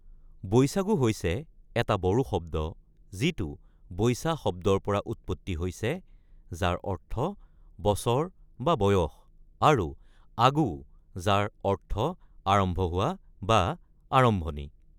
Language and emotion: Assamese, neutral